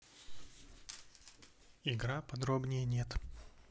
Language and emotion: Russian, neutral